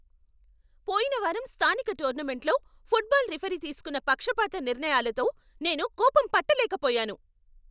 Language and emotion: Telugu, angry